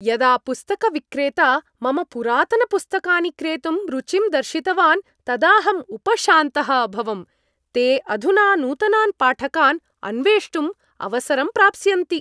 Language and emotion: Sanskrit, happy